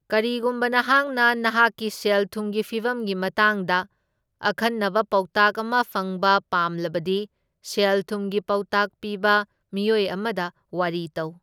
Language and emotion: Manipuri, neutral